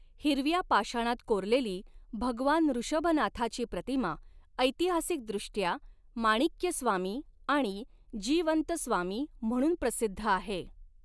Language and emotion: Marathi, neutral